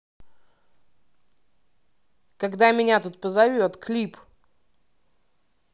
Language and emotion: Russian, neutral